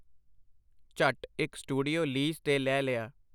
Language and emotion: Punjabi, neutral